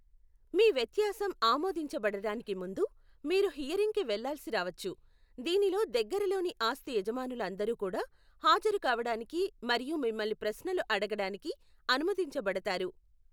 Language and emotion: Telugu, neutral